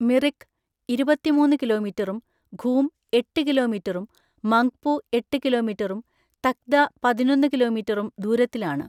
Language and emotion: Malayalam, neutral